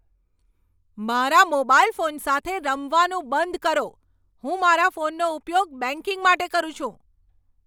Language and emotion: Gujarati, angry